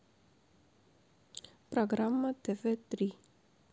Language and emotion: Russian, neutral